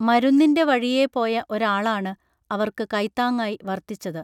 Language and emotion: Malayalam, neutral